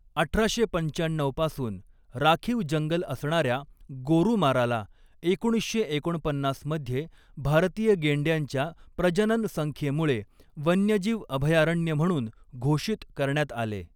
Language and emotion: Marathi, neutral